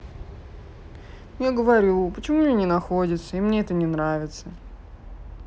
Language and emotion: Russian, sad